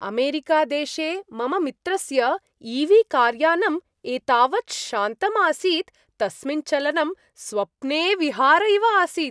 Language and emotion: Sanskrit, happy